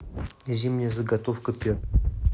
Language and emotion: Russian, neutral